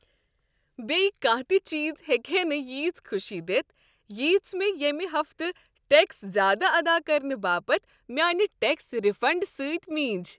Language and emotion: Kashmiri, happy